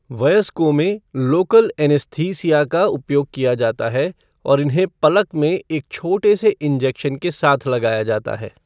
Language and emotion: Hindi, neutral